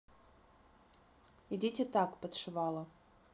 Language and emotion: Russian, neutral